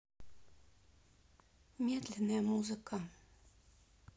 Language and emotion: Russian, sad